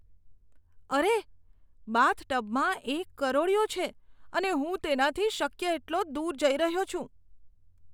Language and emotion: Gujarati, disgusted